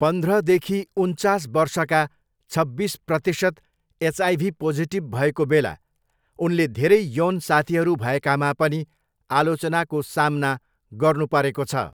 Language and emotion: Nepali, neutral